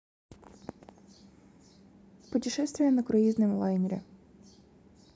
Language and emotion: Russian, neutral